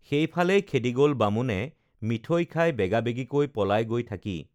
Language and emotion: Assamese, neutral